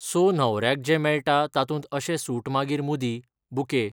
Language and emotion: Goan Konkani, neutral